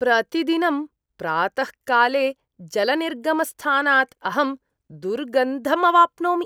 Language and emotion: Sanskrit, disgusted